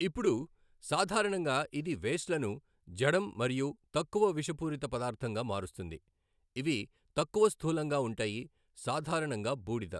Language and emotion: Telugu, neutral